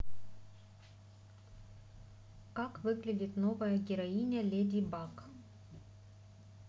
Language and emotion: Russian, neutral